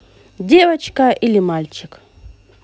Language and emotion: Russian, positive